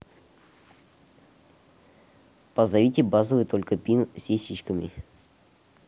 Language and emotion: Russian, neutral